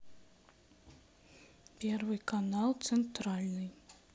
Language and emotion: Russian, neutral